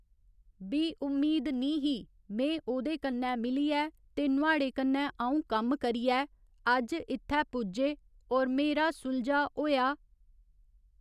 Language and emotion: Dogri, neutral